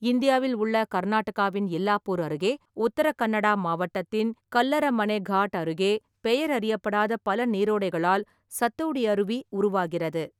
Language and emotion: Tamil, neutral